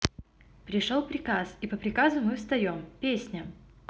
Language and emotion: Russian, neutral